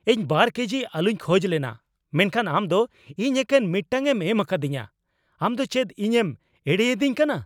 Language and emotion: Santali, angry